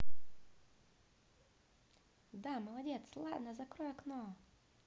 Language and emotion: Russian, positive